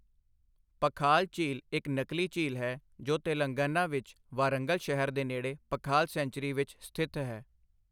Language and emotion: Punjabi, neutral